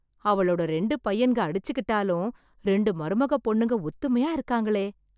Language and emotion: Tamil, surprised